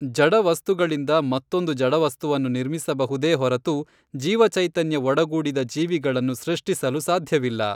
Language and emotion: Kannada, neutral